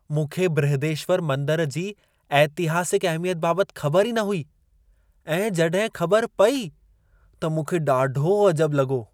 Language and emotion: Sindhi, surprised